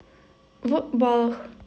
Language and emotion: Russian, neutral